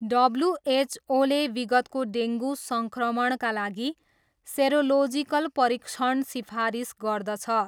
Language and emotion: Nepali, neutral